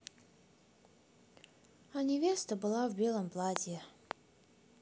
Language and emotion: Russian, sad